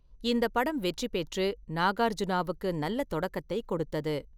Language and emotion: Tamil, neutral